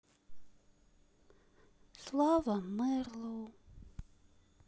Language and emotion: Russian, sad